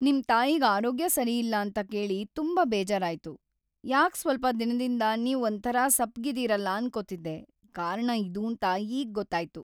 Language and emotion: Kannada, sad